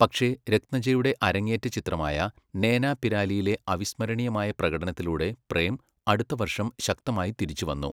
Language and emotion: Malayalam, neutral